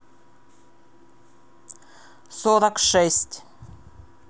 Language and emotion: Russian, neutral